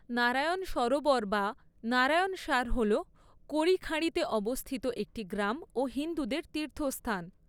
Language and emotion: Bengali, neutral